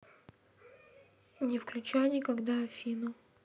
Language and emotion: Russian, neutral